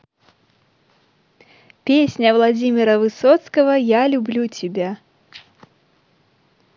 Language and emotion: Russian, positive